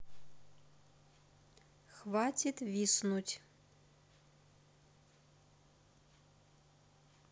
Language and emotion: Russian, neutral